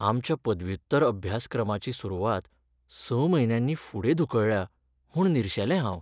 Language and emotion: Goan Konkani, sad